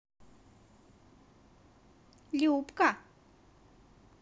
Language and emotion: Russian, positive